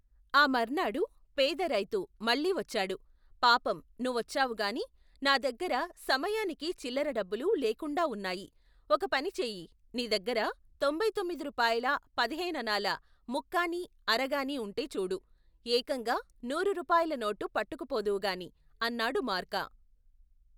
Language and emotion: Telugu, neutral